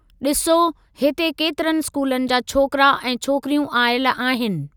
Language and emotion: Sindhi, neutral